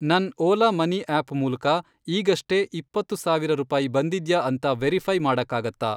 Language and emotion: Kannada, neutral